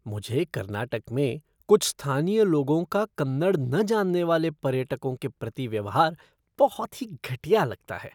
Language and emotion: Hindi, disgusted